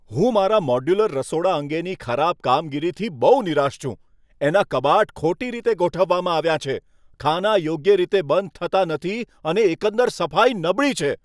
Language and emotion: Gujarati, angry